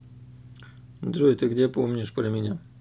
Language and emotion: Russian, neutral